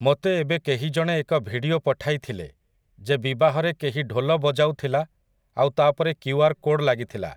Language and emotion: Odia, neutral